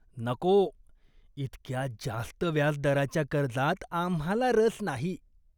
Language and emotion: Marathi, disgusted